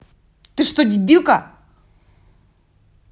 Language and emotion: Russian, angry